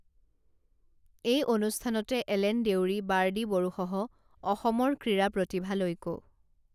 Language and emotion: Assamese, neutral